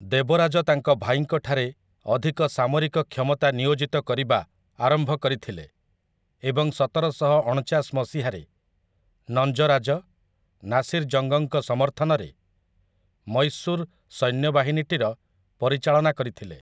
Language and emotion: Odia, neutral